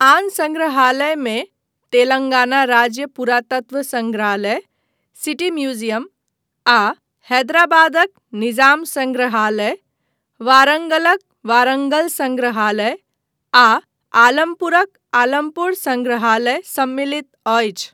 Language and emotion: Maithili, neutral